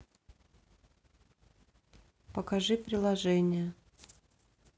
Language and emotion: Russian, neutral